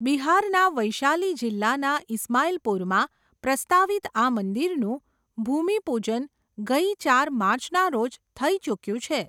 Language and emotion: Gujarati, neutral